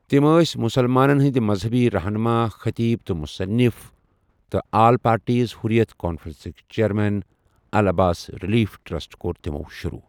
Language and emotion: Kashmiri, neutral